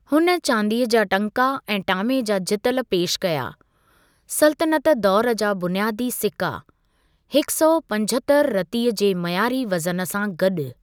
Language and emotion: Sindhi, neutral